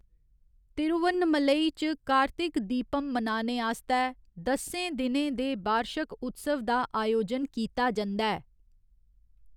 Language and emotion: Dogri, neutral